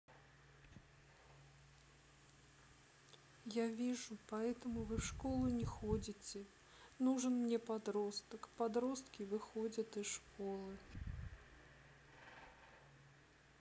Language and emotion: Russian, sad